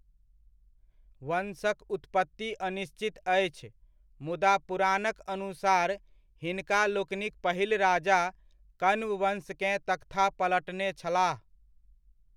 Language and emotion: Maithili, neutral